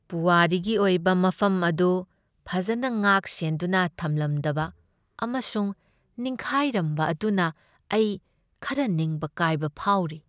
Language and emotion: Manipuri, sad